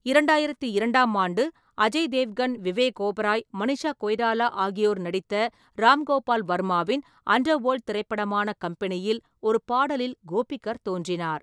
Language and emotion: Tamil, neutral